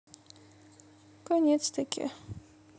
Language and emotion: Russian, sad